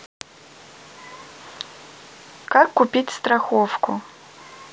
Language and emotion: Russian, neutral